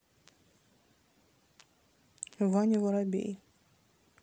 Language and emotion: Russian, neutral